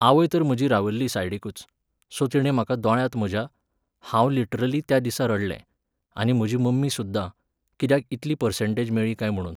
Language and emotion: Goan Konkani, neutral